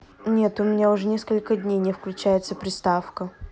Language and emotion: Russian, neutral